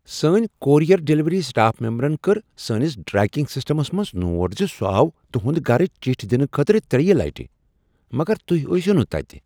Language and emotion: Kashmiri, surprised